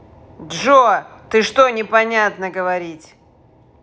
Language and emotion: Russian, angry